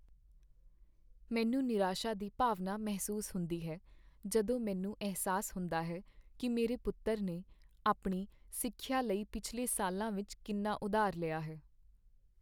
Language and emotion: Punjabi, sad